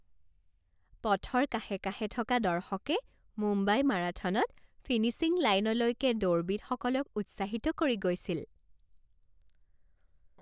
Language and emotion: Assamese, happy